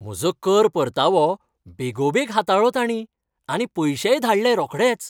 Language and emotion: Goan Konkani, happy